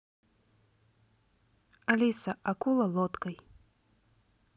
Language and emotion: Russian, neutral